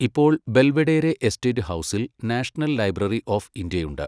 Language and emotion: Malayalam, neutral